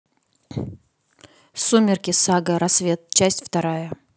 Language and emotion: Russian, neutral